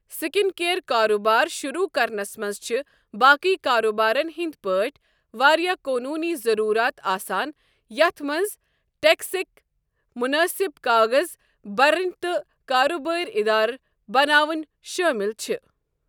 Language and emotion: Kashmiri, neutral